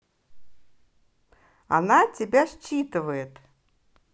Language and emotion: Russian, positive